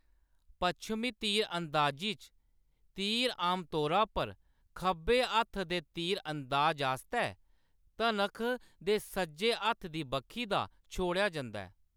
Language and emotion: Dogri, neutral